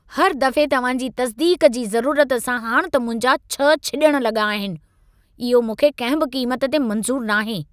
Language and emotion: Sindhi, angry